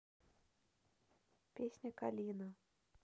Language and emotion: Russian, neutral